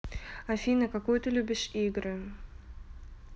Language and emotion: Russian, neutral